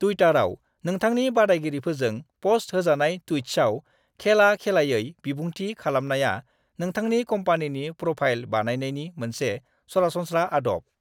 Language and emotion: Bodo, neutral